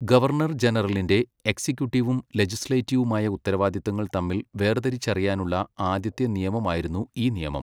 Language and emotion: Malayalam, neutral